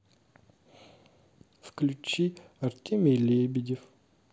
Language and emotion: Russian, sad